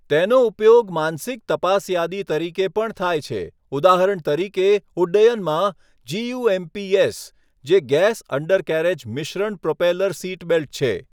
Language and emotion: Gujarati, neutral